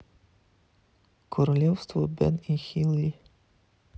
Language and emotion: Russian, neutral